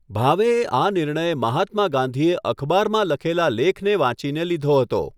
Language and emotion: Gujarati, neutral